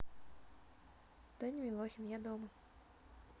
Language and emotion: Russian, neutral